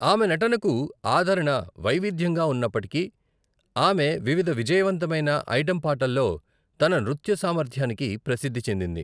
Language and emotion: Telugu, neutral